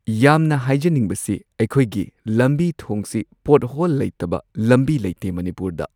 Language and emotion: Manipuri, neutral